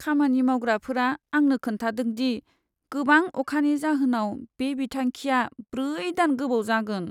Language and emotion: Bodo, sad